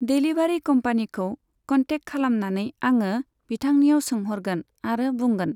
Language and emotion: Bodo, neutral